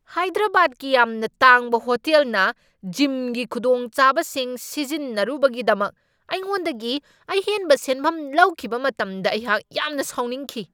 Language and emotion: Manipuri, angry